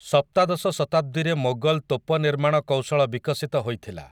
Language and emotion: Odia, neutral